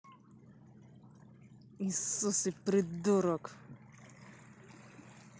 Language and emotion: Russian, angry